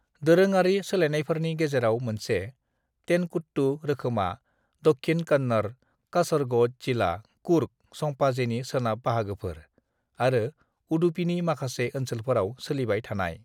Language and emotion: Bodo, neutral